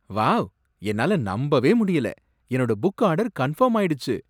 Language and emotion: Tamil, surprised